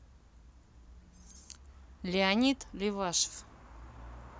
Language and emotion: Russian, neutral